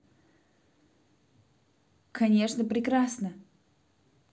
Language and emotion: Russian, positive